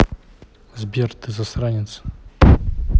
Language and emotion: Russian, neutral